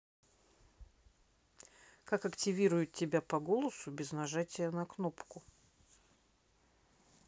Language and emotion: Russian, neutral